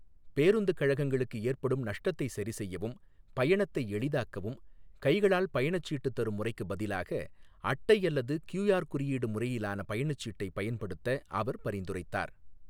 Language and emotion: Tamil, neutral